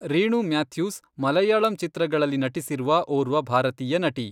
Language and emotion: Kannada, neutral